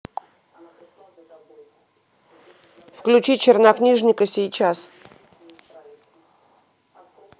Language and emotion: Russian, neutral